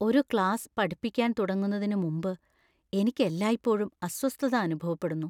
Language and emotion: Malayalam, fearful